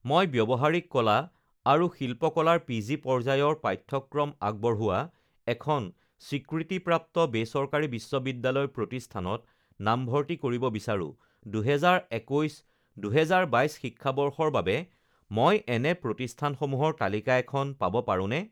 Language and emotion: Assamese, neutral